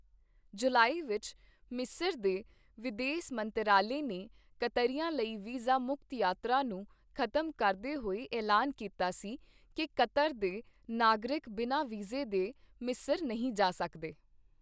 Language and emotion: Punjabi, neutral